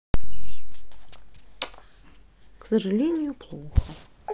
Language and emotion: Russian, sad